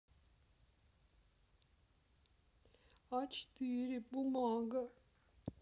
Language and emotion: Russian, sad